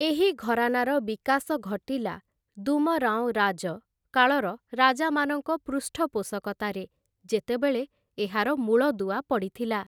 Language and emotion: Odia, neutral